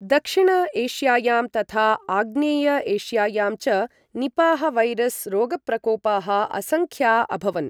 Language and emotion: Sanskrit, neutral